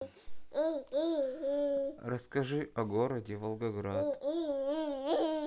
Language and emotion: Russian, sad